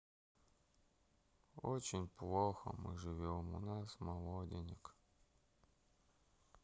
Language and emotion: Russian, sad